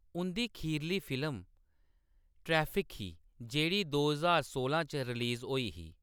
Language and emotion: Dogri, neutral